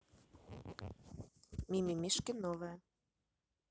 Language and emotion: Russian, neutral